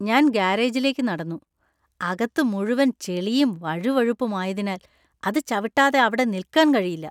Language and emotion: Malayalam, disgusted